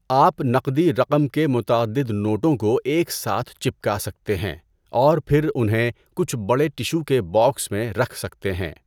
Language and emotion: Urdu, neutral